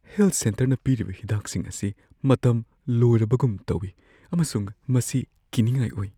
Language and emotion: Manipuri, fearful